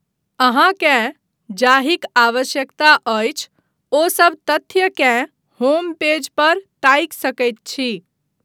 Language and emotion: Maithili, neutral